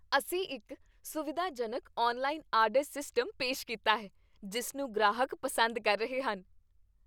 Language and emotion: Punjabi, happy